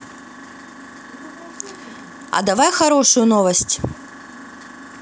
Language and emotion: Russian, neutral